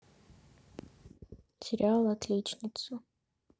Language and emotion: Russian, neutral